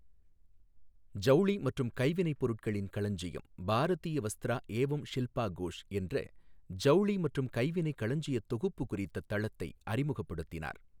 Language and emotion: Tamil, neutral